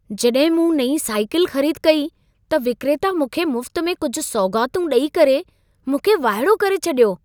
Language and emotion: Sindhi, surprised